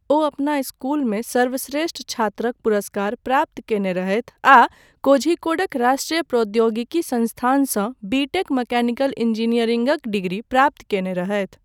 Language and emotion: Maithili, neutral